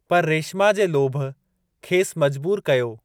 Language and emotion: Sindhi, neutral